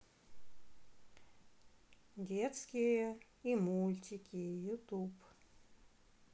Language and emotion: Russian, neutral